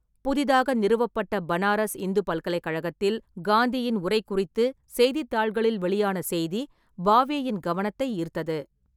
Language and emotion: Tamil, neutral